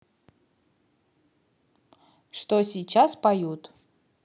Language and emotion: Russian, neutral